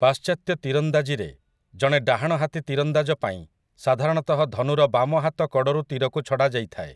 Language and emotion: Odia, neutral